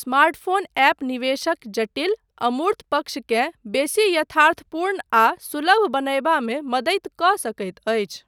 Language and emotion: Maithili, neutral